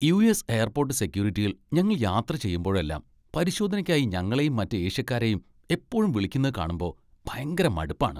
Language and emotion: Malayalam, disgusted